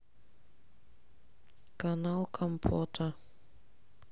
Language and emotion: Russian, neutral